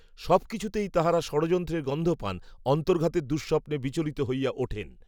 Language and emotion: Bengali, neutral